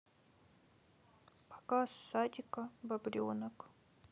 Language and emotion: Russian, sad